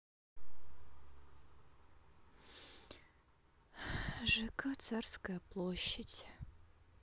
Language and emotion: Russian, sad